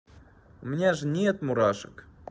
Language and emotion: Russian, neutral